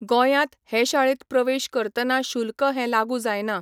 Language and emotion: Goan Konkani, neutral